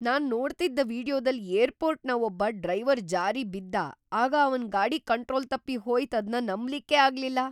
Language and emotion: Kannada, surprised